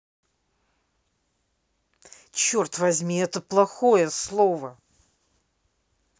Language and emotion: Russian, angry